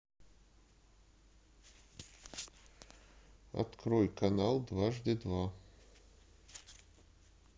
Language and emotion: Russian, neutral